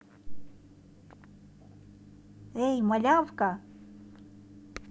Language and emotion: Russian, positive